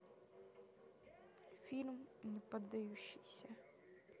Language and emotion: Russian, neutral